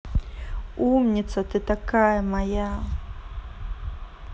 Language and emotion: Russian, positive